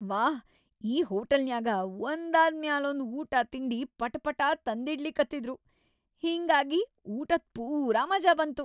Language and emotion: Kannada, happy